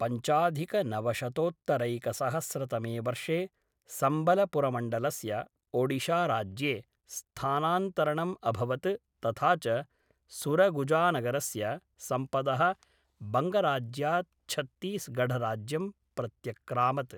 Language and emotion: Sanskrit, neutral